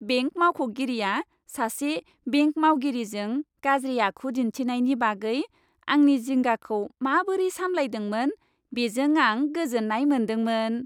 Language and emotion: Bodo, happy